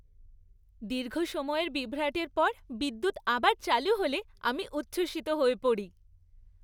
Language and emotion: Bengali, happy